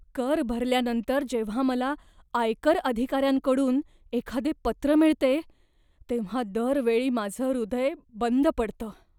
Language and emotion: Marathi, fearful